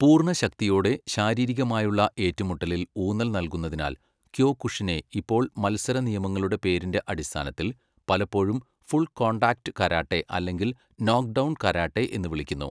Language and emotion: Malayalam, neutral